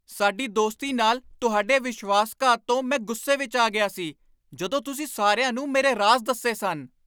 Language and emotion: Punjabi, angry